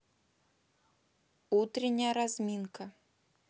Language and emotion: Russian, neutral